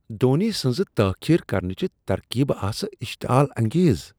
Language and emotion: Kashmiri, disgusted